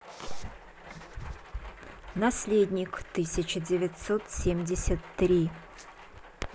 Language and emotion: Russian, neutral